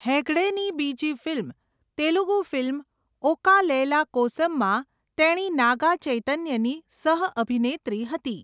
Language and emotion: Gujarati, neutral